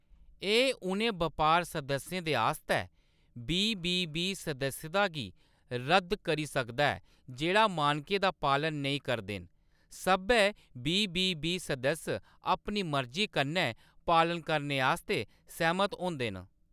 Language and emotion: Dogri, neutral